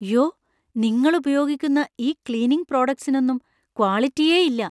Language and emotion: Malayalam, fearful